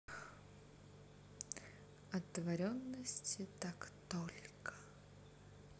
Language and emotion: Russian, neutral